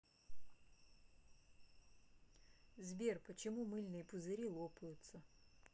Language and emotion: Russian, neutral